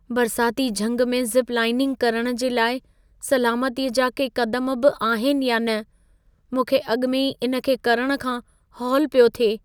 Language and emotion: Sindhi, fearful